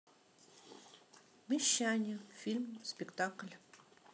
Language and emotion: Russian, neutral